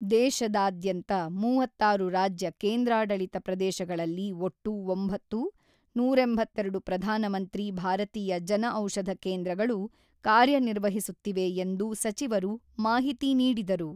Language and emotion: Kannada, neutral